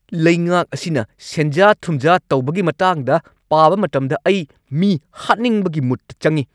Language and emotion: Manipuri, angry